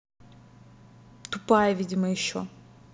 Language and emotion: Russian, angry